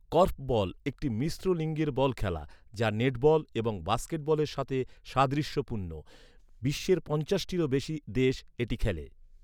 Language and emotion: Bengali, neutral